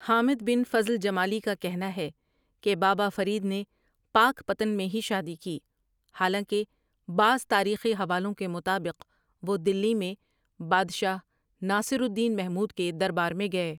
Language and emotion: Urdu, neutral